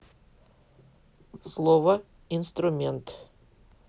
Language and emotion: Russian, neutral